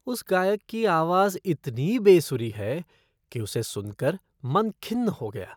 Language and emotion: Hindi, disgusted